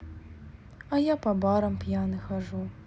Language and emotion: Russian, sad